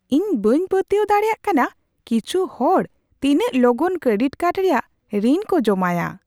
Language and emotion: Santali, surprised